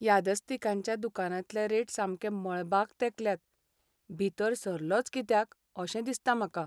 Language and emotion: Goan Konkani, sad